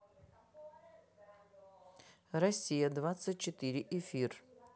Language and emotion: Russian, neutral